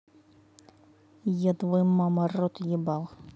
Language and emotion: Russian, angry